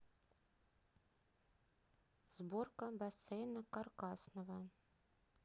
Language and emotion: Russian, neutral